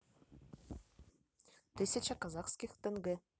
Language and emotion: Russian, neutral